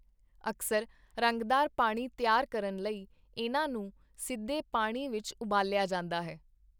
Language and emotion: Punjabi, neutral